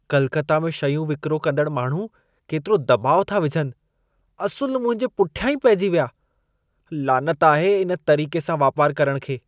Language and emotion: Sindhi, disgusted